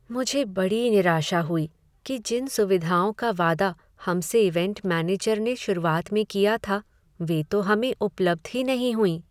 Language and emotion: Hindi, sad